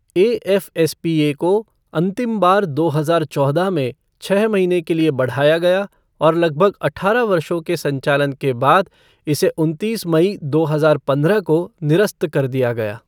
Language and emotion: Hindi, neutral